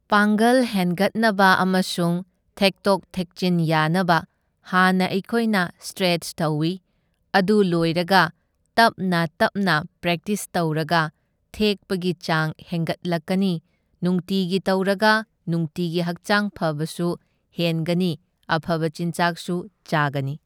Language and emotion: Manipuri, neutral